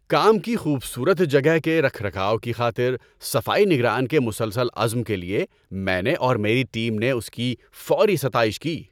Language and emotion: Urdu, happy